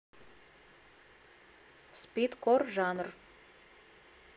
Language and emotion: Russian, neutral